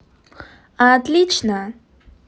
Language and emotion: Russian, positive